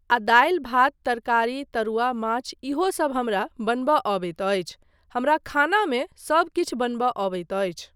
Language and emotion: Maithili, neutral